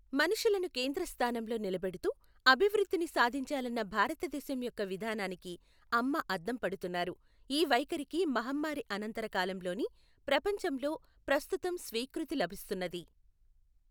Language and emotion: Telugu, neutral